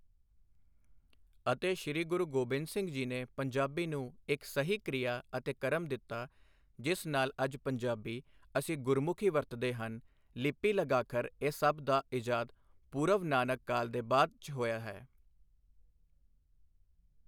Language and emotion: Punjabi, neutral